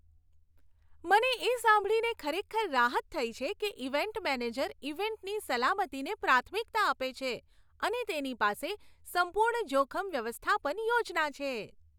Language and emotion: Gujarati, happy